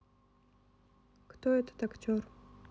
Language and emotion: Russian, neutral